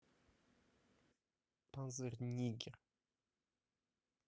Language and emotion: Russian, neutral